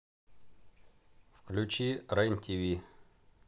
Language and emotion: Russian, neutral